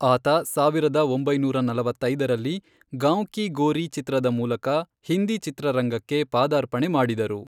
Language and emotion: Kannada, neutral